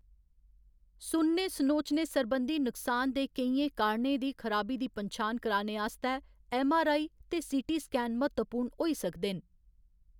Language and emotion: Dogri, neutral